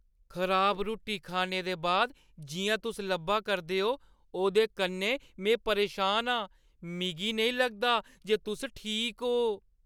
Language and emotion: Dogri, fearful